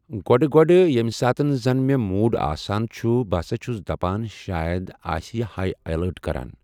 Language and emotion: Kashmiri, neutral